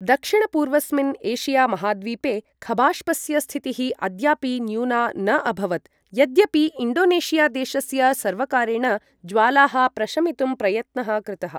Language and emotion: Sanskrit, neutral